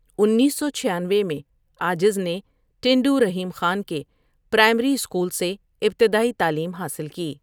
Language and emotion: Urdu, neutral